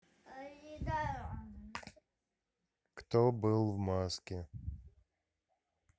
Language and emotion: Russian, neutral